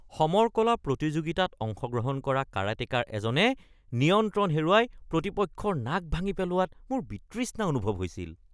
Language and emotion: Assamese, disgusted